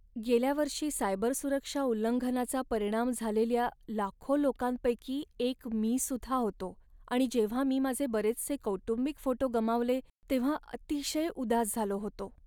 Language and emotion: Marathi, sad